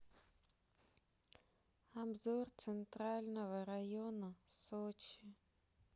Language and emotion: Russian, sad